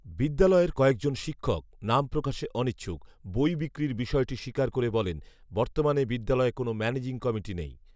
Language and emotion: Bengali, neutral